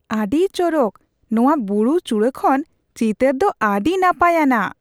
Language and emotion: Santali, surprised